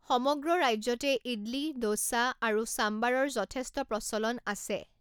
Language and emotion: Assamese, neutral